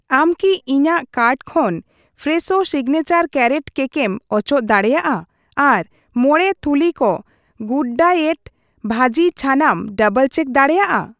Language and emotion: Santali, neutral